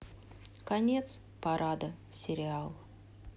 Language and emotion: Russian, sad